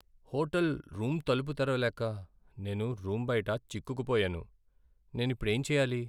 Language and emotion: Telugu, sad